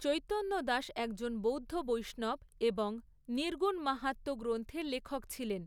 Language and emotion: Bengali, neutral